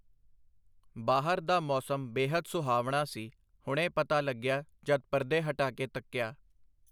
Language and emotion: Punjabi, neutral